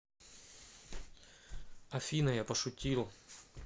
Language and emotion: Russian, neutral